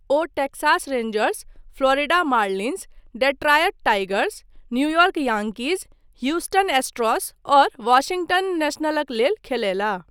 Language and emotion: Maithili, neutral